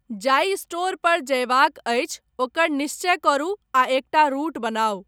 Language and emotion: Maithili, neutral